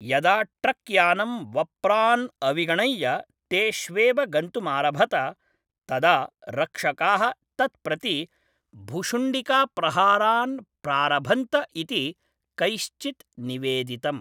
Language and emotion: Sanskrit, neutral